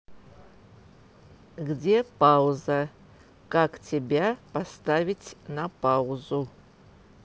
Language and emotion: Russian, neutral